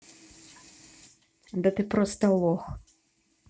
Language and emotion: Russian, angry